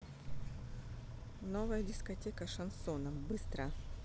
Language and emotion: Russian, neutral